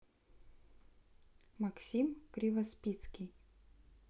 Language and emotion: Russian, neutral